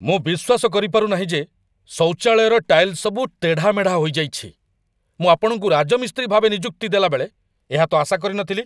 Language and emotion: Odia, angry